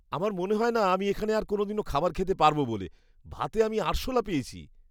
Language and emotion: Bengali, disgusted